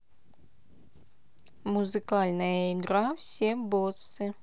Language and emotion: Russian, neutral